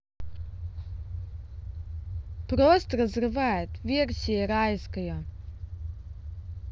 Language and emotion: Russian, neutral